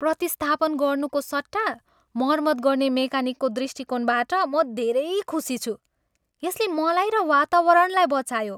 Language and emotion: Nepali, happy